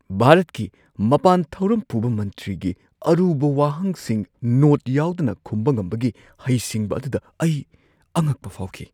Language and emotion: Manipuri, surprised